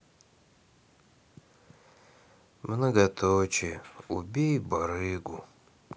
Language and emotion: Russian, sad